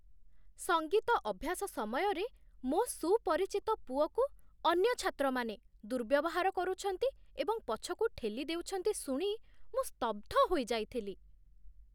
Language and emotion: Odia, surprised